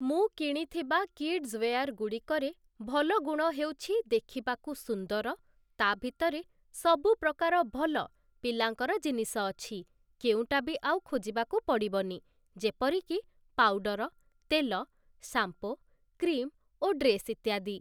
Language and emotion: Odia, neutral